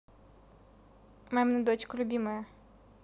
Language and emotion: Russian, neutral